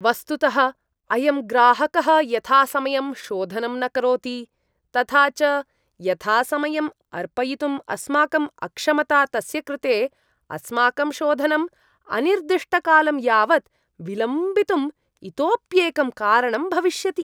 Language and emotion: Sanskrit, disgusted